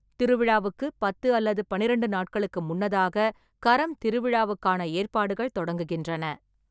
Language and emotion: Tamil, neutral